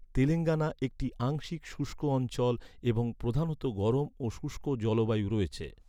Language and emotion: Bengali, neutral